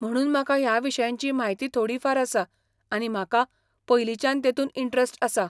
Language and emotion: Goan Konkani, neutral